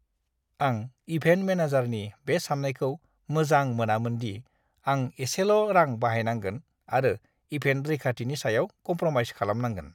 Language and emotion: Bodo, disgusted